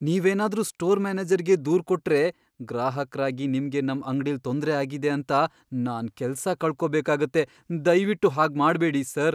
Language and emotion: Kannada, fearful